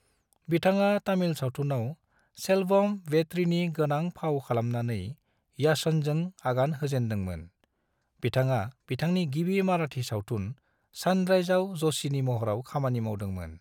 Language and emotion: Bodo, neutral